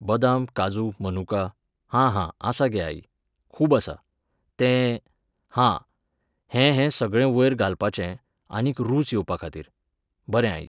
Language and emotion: Goan Konkani, neutral